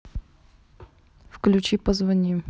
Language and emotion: Russian, neutral